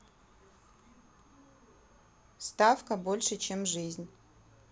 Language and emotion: Russian, neutral